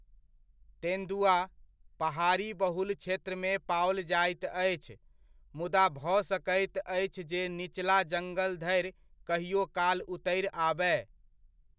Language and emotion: Maithili, neutral